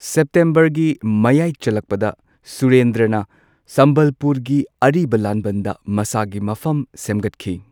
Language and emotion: Manipuri, neutral